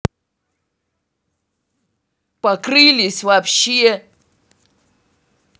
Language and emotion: Russian, angry